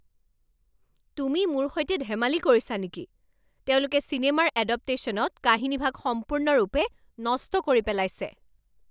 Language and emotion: Assamese, angry